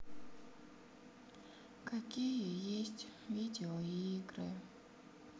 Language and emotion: Russian, sad